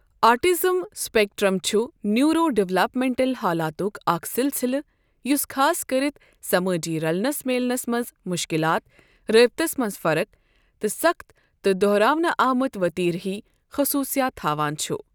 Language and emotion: Kashmiri, neutral